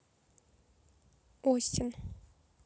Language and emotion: Russian, neutral